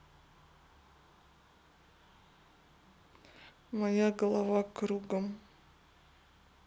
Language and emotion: Russian, sad